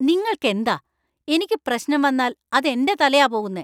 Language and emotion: Malayalam, angry